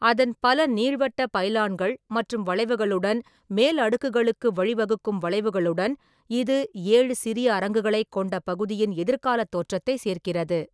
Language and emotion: Tamil, neutral